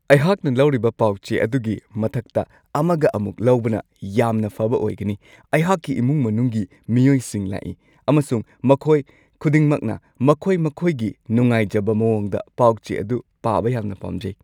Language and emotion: Manipuri, happy